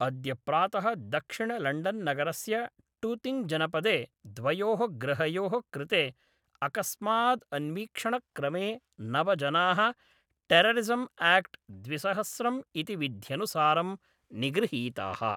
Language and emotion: Sanskrit, neutral